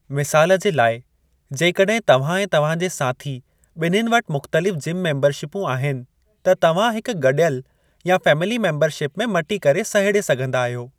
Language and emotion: Sindhi, neutral